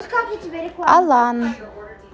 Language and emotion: Russian, neutral